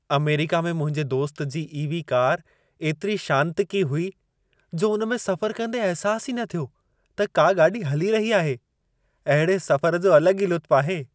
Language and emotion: Sindhi, happy